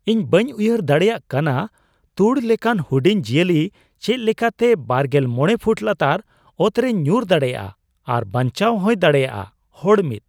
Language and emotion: Santali, surprised